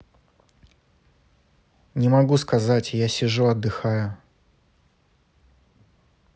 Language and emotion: Russian, neutral